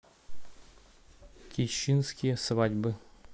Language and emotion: Russian, neutral